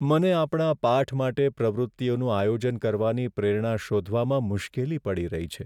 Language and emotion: Gujarati, sad